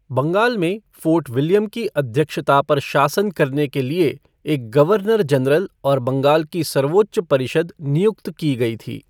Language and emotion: Hindi, neutral